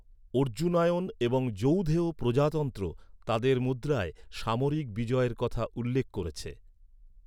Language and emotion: Bengali, neutral